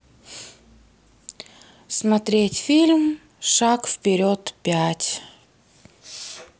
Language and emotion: Russian, neutral